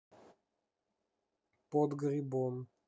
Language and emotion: Russian, neutral